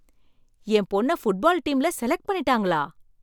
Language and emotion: Tamil, surprised